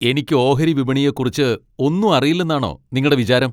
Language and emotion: Malayalam, angry